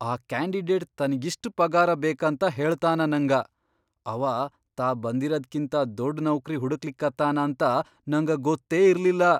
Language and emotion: Kannada, surprised